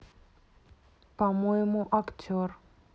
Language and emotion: Russian, neutral